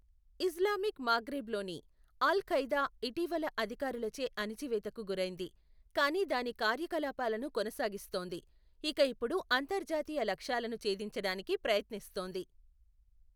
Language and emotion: Telugu, neutral